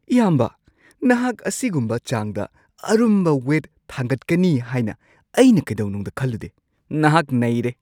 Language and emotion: Manipuri, surprised